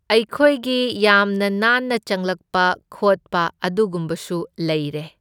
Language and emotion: Manipuri, neutral